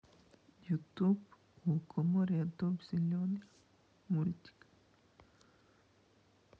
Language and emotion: Russian, sad